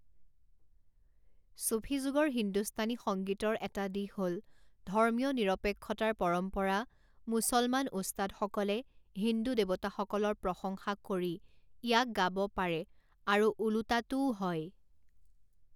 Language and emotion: Assamese, neutral